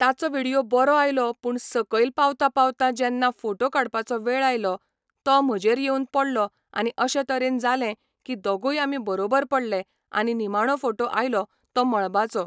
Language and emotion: Goan Konkani, neutral